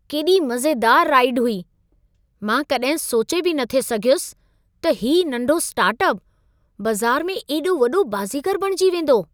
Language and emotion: Sindhi, surprised